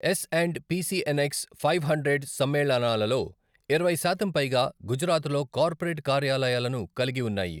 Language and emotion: Telugu, neutral